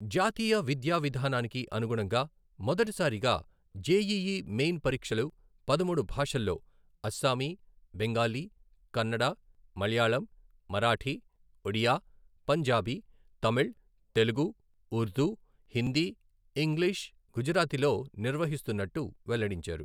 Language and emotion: Telugu, neutral